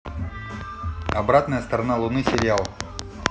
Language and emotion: Russian, neutral